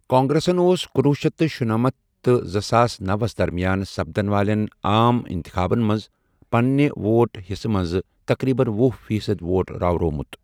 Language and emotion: Kashmiri, neutral